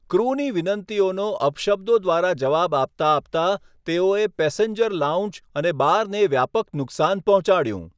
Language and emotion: Gujarati, neutral